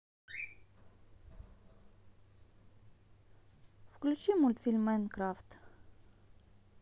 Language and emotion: Russian, neutral